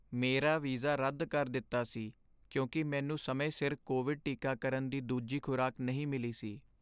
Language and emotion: Punjabi, sad